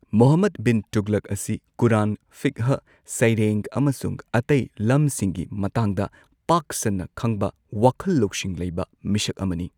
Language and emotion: Manipuri, neutral